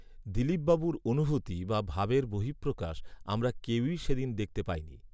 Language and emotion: Bengali, neutral